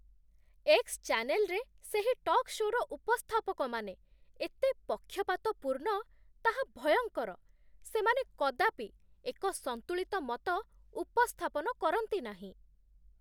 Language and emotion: Odia, disgusted